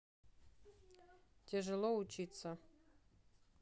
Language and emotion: Russian, neutral